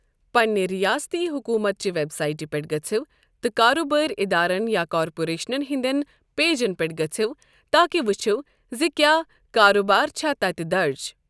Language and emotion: Kashmiri, neutral